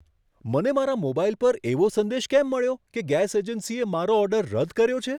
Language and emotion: Gujarati, surprised